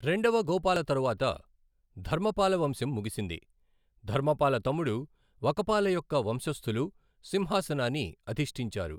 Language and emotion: Telugu, neutral